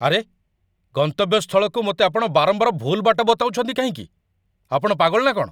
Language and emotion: Odia, angry